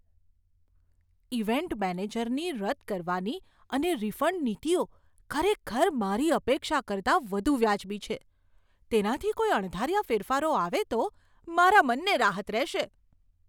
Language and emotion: Gujarati, surprised